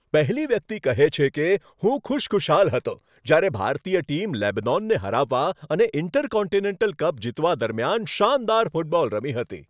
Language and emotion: Gujarati, happy